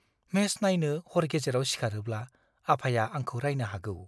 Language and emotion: Bodo, fearful